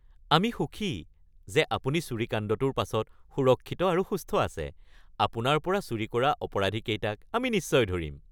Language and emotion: Assamese, happy